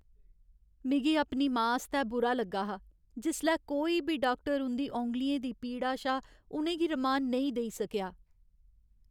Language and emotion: Dogri, sad